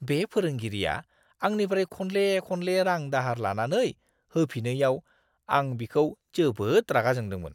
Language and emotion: Bodo, disgusted